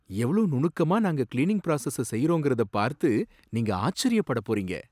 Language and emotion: Tamil, surprised